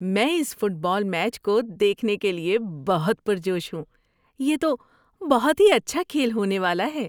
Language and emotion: Urdu, happy